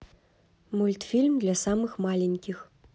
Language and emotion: Russian, neutral